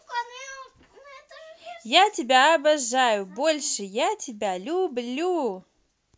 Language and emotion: Russian, positive